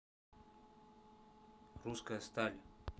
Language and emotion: Russian, neutral